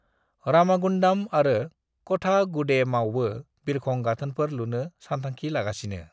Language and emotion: Bodo, neutral